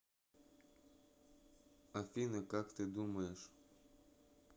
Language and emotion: Russian, neutral